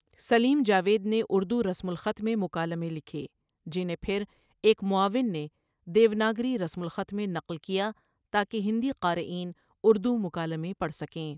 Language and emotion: Urdu, neutral